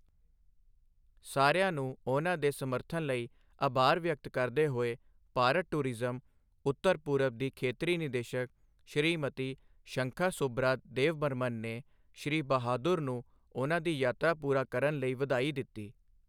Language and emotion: Punjabi, neutral